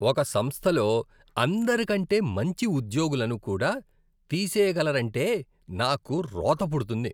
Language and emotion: Telugu, disgusted